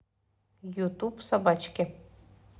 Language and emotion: Russian, neutral